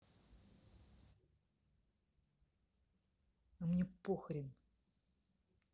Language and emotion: Russian, angry